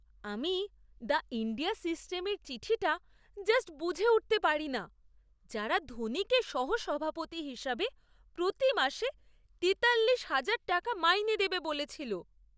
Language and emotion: Bengali, surprised